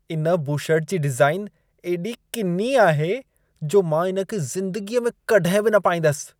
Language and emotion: Sindhi, disgusted